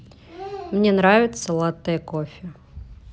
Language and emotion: Russian, neutral